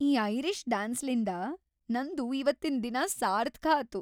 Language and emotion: Kannada, happy